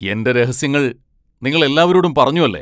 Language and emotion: Malayalam, angry